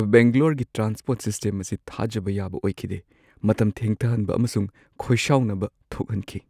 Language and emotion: Manipuri, sad